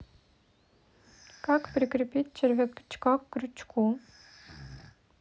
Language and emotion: Russian, neutral